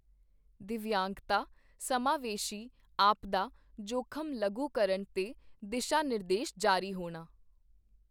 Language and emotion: Punjabi, neutral